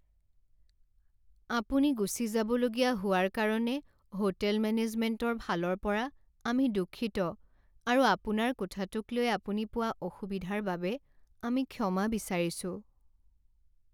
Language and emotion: Assamese, sad